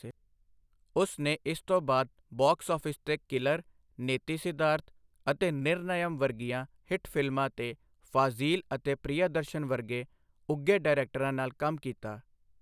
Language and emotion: Punjabi, neutral